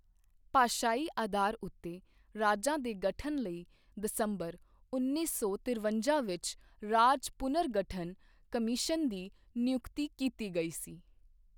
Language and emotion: Punjabi, neutral